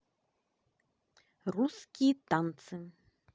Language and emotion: Russian, positive